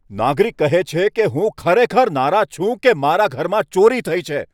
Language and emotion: Gujarati, angry